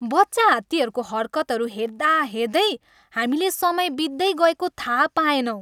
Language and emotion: Nepali, happy